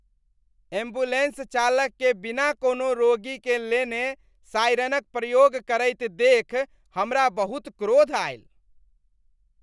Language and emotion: Maithili, disgusted